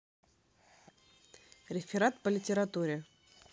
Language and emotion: Russian, neutral